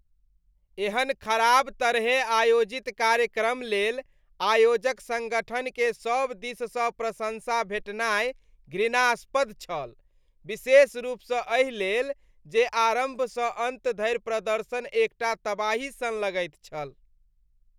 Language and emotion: Maithili, disgusted